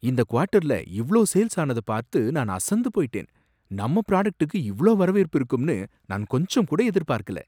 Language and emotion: Tamil, surprised